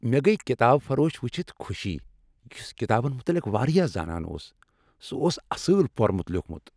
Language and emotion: Kashmiri, happy